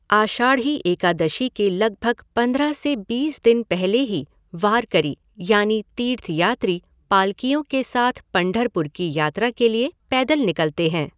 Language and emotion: Hindi, neutral